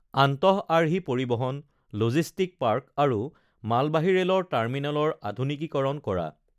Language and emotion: Assamese, neutral